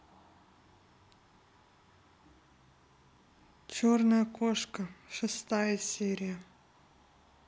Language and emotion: Russian, neutral